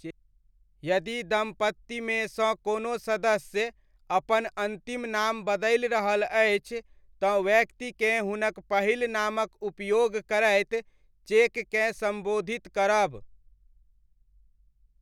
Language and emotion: Maithili, neutral